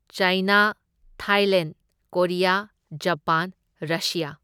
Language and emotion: Manipuri, neutral